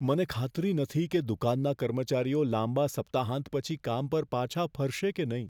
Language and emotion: Gujarati, fearful